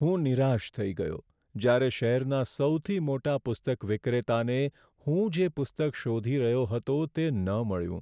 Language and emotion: Gujarati, sad